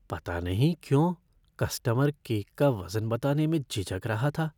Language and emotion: Hindi, fearful